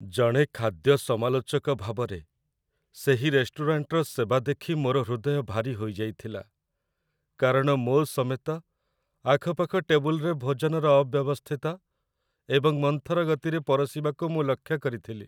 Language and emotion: Odia, sad